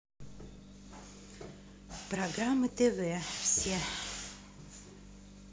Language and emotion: Russian, neutral